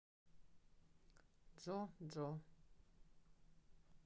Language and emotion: Russian, neutral